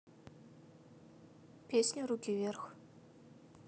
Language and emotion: Russian, neutral